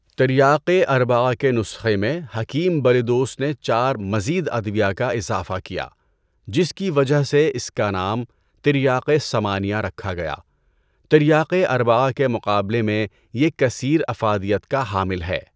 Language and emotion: Urdu, neutral